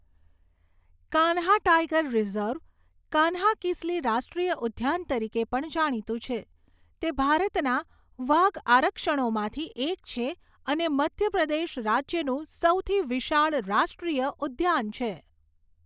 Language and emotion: Gujarati, neutral